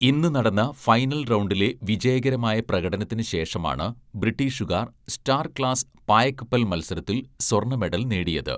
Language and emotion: Malayalam, neutral